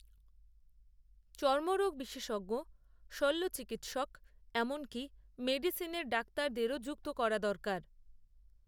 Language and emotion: Bengali, neutral